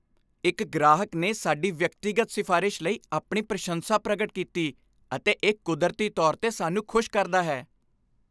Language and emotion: Punjabi, happy